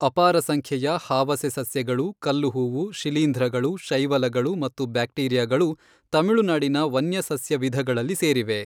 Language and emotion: Kannada, neutral